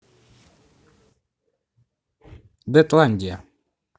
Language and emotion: Russian, neutral